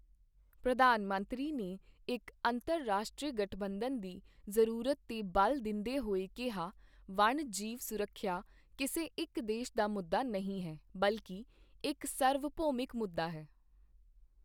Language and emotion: Punjabi, neutral